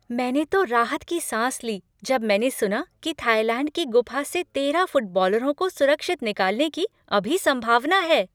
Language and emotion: Hindi, happy